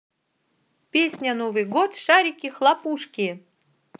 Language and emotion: Russian, positive